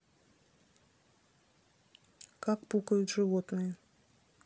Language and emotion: Russian, neutral